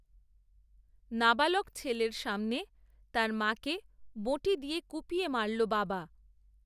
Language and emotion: Bengali, neutral